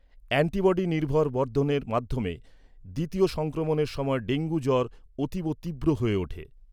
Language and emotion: Bengali, neutral